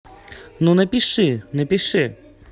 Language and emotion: Russian, angry